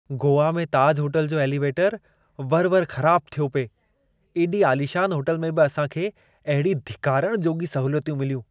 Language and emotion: Sindhi, disgusted